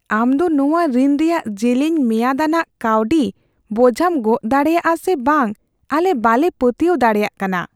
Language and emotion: Santali, fearful